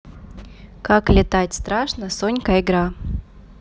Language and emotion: Russian, neutral